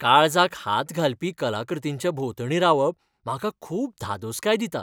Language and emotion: Goan Konkani, happy